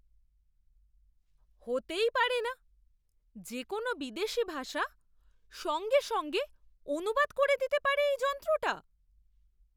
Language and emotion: Bengali, surprised